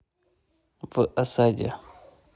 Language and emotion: Russian, neutral